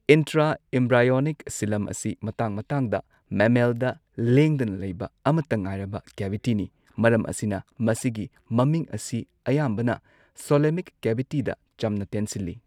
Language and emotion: Manipuri, neutral